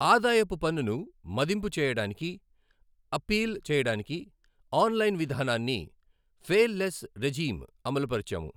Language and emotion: Telugu, neutral